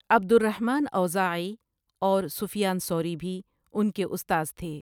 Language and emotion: Urdu, neutral